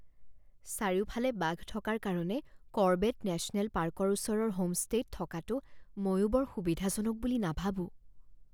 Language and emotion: Assamese, fearful